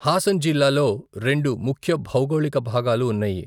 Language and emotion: Telugu, neutral